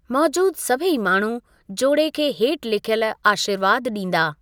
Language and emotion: Sindhi, neutral